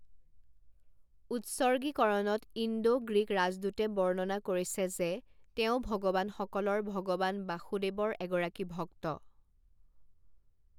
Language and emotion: Assamese, neutral